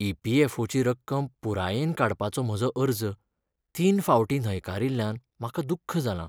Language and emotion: Goan Konkani, sad